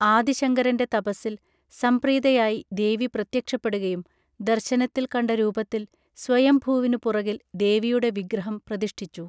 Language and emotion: Malayalam, neutral